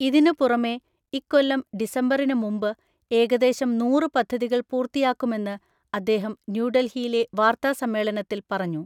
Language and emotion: Malayalam, neutral